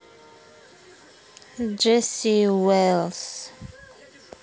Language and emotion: Russian, neutral